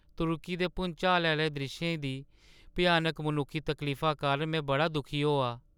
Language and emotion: Dogri, sad